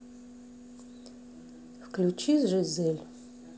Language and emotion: Russian, neutral